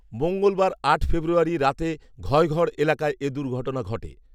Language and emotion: Bengali, neutral